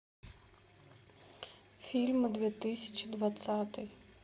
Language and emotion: Russian, sad